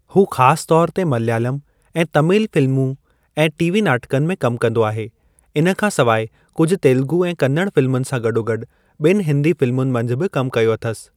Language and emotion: Sindhi, neutral